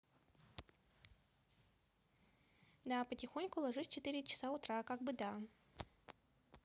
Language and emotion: Russian, neutral